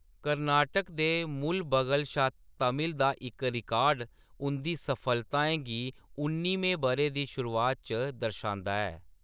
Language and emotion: Dogri, neutral